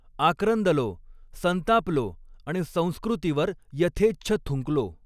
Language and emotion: Marathi, neutral